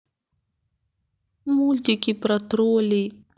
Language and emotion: Russian, sad